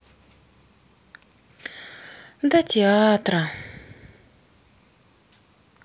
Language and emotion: Russian, sad